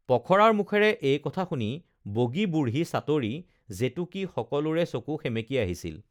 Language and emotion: Assamese, neutral